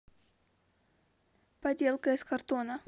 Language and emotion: Russian, neutral